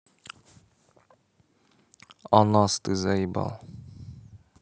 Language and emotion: Russian, neutral